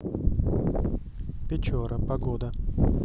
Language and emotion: Russian, neutral